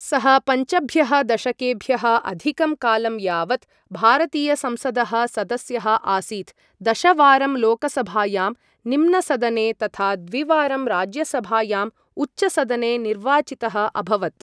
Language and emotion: Sanskrit, neutral